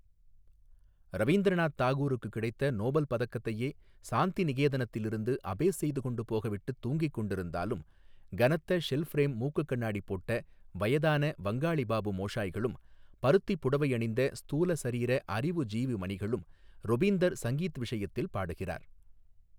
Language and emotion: Tamil, neutral